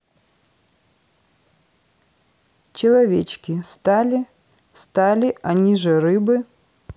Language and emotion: Russian, neutral